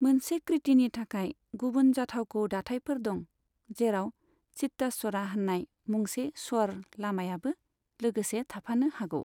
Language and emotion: Bodo, neutral